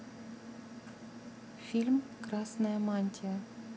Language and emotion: Russian, neutral